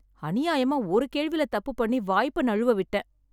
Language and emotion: Tamil, sad